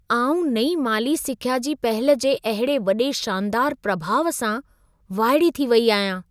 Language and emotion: Sindhi, surprised